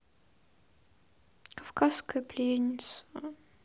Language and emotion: Russian, sad